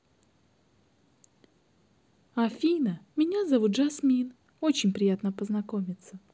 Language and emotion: Russian, neutral